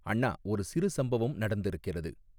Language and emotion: Tamil, neutral